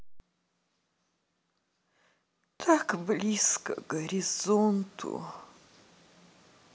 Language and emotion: Russian, sad